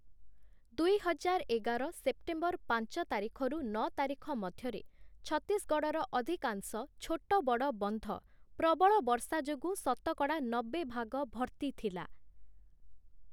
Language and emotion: Odia, neutral